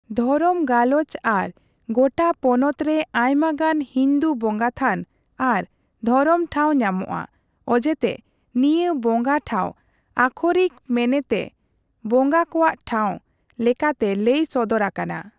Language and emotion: Santali, neutral